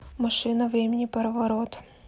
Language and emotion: Russian, neutral